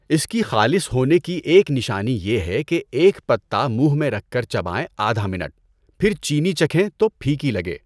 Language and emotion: Urdu, neutral